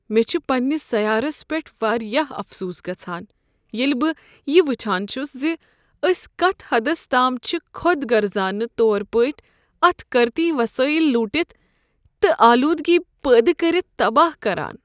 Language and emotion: Kashmiri, sad